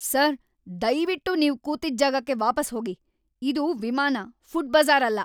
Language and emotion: Kannada, angry